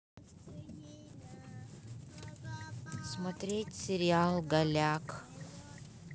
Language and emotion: Russian, neutral